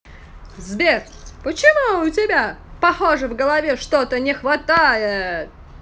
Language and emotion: Russian, positive